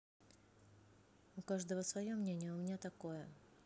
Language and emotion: Russian, neutral